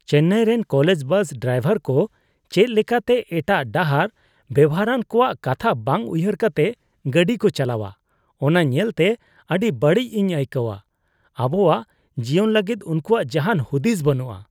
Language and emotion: Santali, disgusted